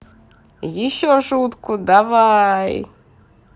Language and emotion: Russian, positive